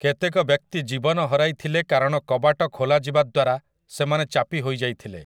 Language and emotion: Odia, neutral